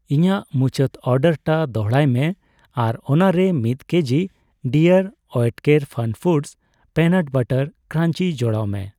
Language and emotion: Santali, neutral